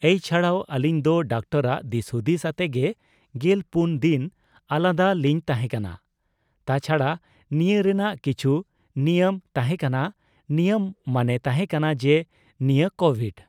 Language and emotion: Santali, neutral